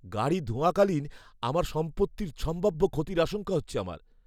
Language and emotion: Bengali, fearful